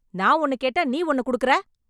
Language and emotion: Tamil, angry